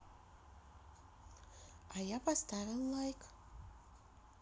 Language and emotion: Russian, positive